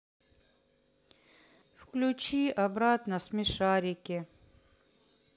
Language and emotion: Russian, sad